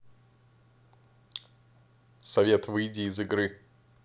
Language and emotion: Russian, neutral